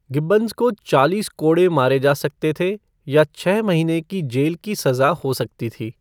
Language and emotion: Hindi, neutral